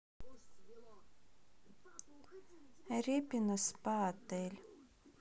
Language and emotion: Russian, sad